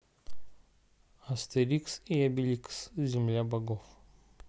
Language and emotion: Russian, neutral